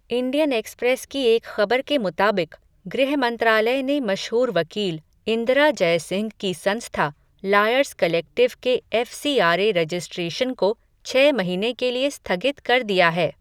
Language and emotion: Hindi, neutral